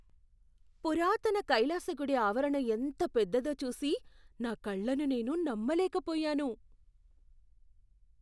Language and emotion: Telugu, surprised